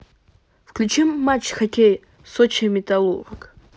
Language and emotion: Russian, neutral